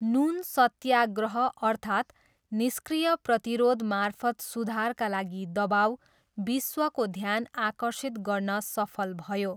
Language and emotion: Nepali, neutral